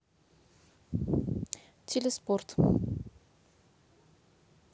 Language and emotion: Russian, neutral